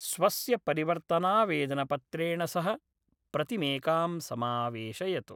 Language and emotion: Sanskrit, neutral